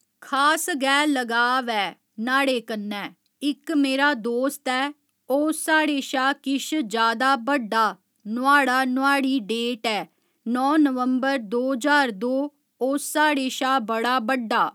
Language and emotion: Dogri, neutral